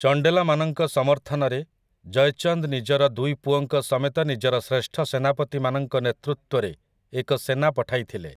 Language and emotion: Odia, neutral